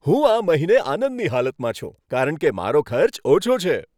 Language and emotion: Gujarati, happy